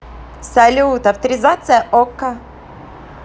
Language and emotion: Russian, positive